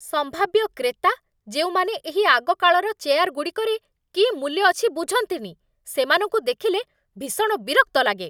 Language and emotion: Odia, angry